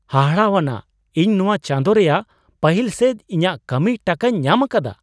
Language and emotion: Santali, surprised